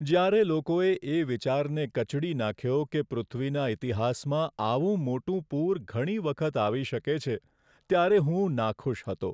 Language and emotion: Gujarati, sad